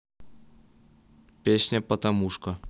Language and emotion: Russian, neutral